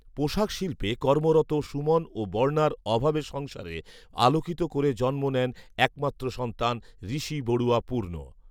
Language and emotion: Bengali, neutral